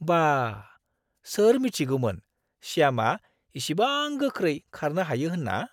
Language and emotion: Bodo, surprised